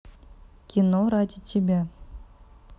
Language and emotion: Russian, neutral